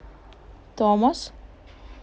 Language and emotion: Russian, neutral